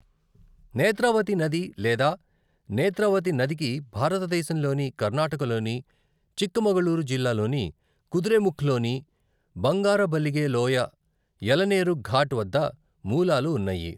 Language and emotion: Telugu, neutral